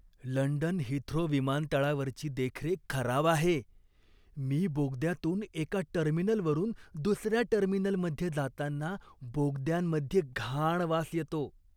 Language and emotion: Marathi, disgusted